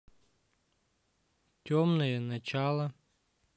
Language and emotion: Russian, neutral